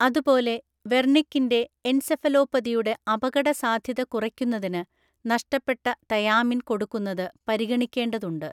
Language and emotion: Malayalam, neutral